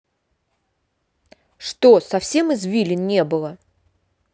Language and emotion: Russian, angry